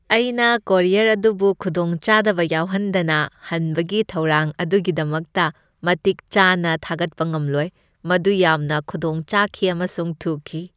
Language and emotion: Manipuri, happy